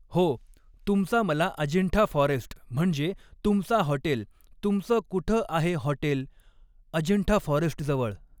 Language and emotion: Marathi, neutral